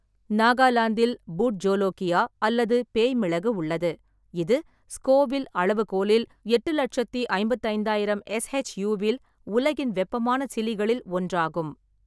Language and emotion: Tamil, neutral